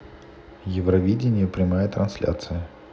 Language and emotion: Russian, neutral